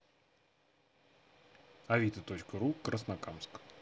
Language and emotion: Russian, neutral